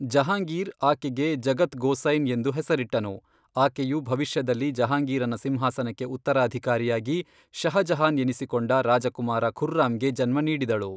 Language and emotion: Kannada, neutral